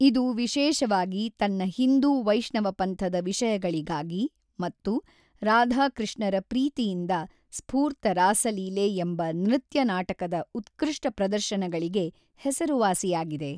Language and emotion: Kannada, neutral